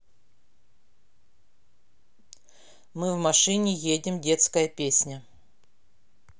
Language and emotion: Russian, neutral